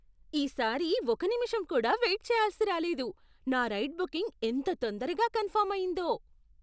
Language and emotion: Telugu, surprised